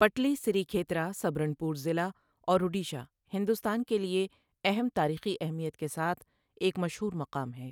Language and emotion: Urdu, neutral